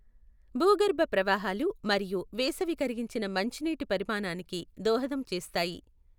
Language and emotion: Telugu, neutral